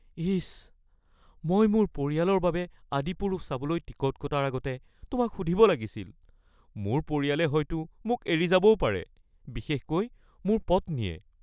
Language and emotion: Assamese, fearful